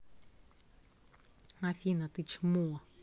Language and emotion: Russian, angry